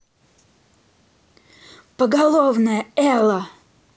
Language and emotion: Russian, angry